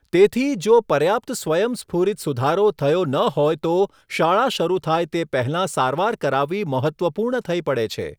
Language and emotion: Gujarati, neutral